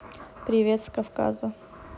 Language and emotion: Russian, neutral